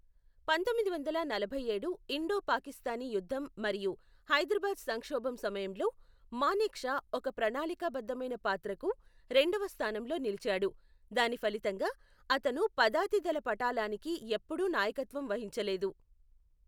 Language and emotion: Telugu, neutral